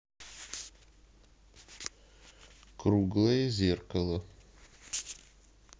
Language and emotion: Russian, neutral